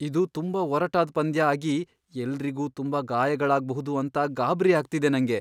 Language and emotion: Kannada, fearful